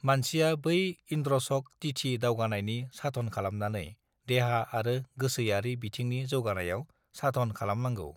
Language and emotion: Bodo, neutral